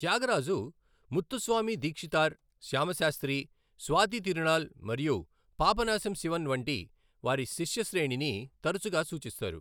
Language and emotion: Telugu, neutral